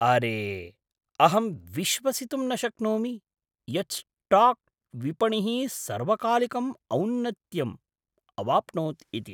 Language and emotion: Sanskrit, surprised